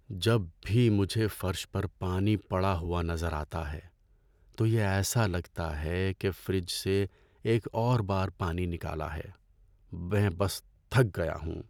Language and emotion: Urdu, sad